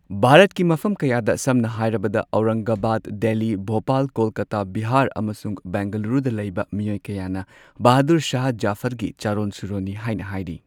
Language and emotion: Manipuri, neutral